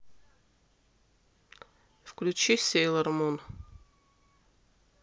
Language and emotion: Russian, neutral